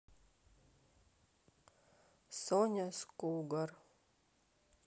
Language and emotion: Russian, sad